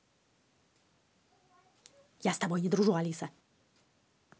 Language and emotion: Russian, angry